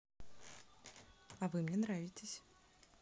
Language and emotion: Russian, positive